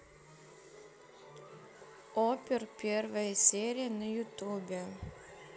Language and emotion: Russian, neutral